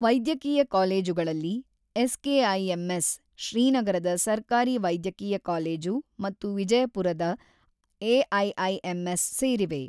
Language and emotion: Kannada, neutral